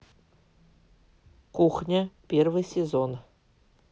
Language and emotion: Russian, neutral